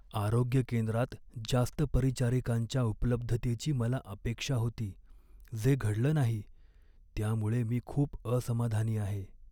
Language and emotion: Marathi, sad